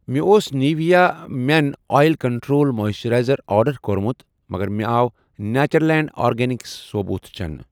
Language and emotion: Kashmiri, neutral